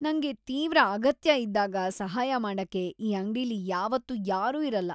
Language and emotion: Kannada, disgusted